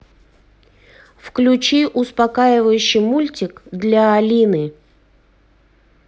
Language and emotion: Russian, neutral